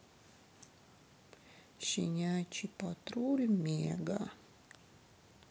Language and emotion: Russian, sad